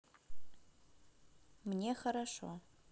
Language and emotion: Russian, neutral